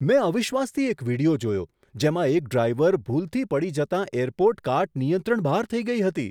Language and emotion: Gujarati, surprised